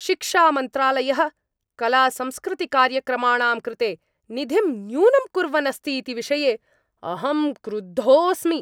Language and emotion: Sanskrit, angry